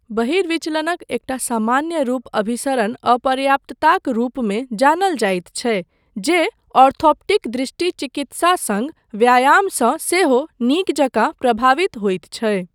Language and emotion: Maithili, neutral